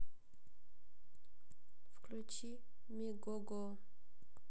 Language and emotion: Russian, sad